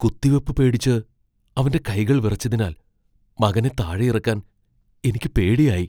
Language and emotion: Malayalam, fearful